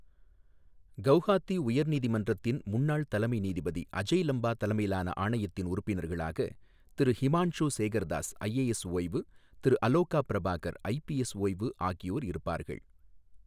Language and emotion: Tamil, neutral